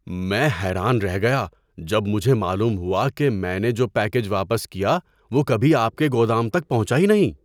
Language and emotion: Urdu, surprised